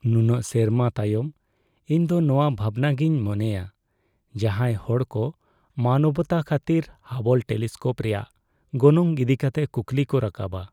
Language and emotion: Santali, sad